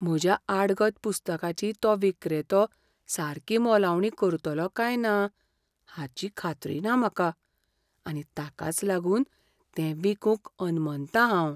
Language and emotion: Goan Konkani, fearful